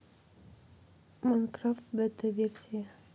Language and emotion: Russian, neutral